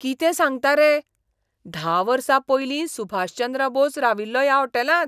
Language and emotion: Goan Konkani, surprised